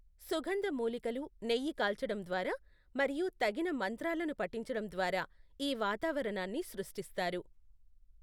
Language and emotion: Telugu, neutral